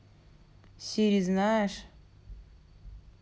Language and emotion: Russian, neutral